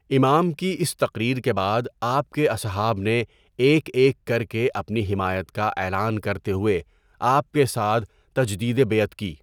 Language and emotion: Urdu, neutral